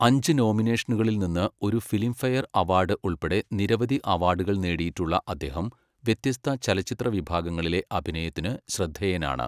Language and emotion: Malayalam, neutral